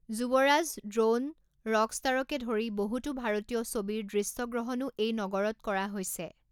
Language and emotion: Assamese, neutral